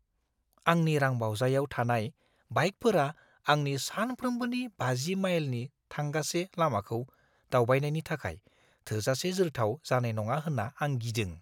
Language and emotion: Bodo, fearful